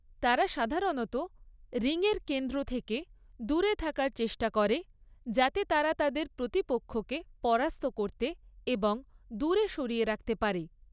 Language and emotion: Bengali, neutral